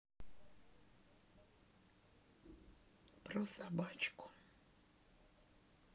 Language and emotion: Russian, sad